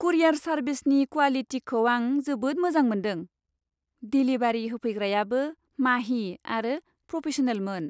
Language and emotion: Bodo, happy